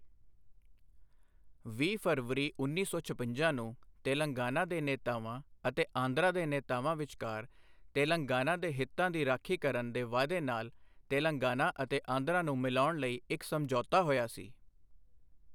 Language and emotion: Punjabi, neutral